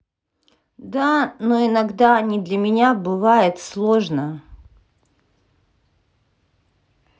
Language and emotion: Russian, neutral